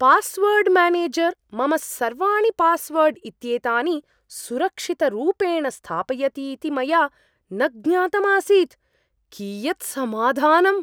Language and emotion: Sanskrit, surprised